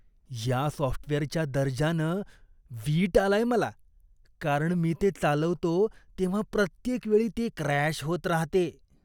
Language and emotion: Marathi, disgusted